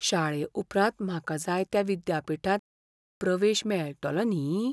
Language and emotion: Goan Konkani, fearful